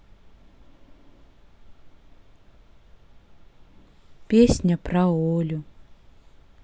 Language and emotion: Russian, sad